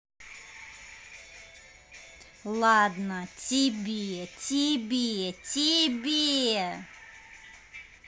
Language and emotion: Russian, angry